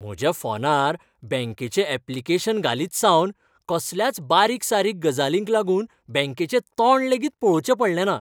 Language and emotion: Goan Konkani, happy